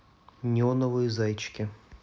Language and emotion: Russian, neutral